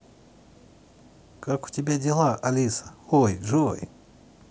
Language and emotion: Russian, positive